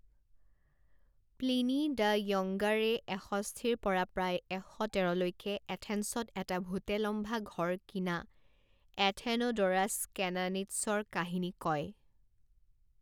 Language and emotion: Assamese, neutral